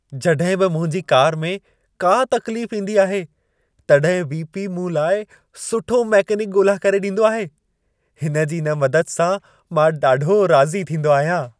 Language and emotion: Sindhi, happy